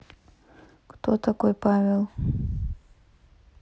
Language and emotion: Russian, neutral